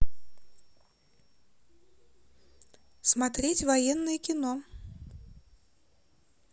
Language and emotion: Russian, positive